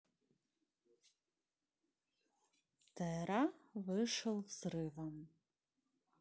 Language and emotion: Russian, neutral